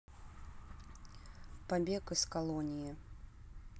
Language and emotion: Russian, neutral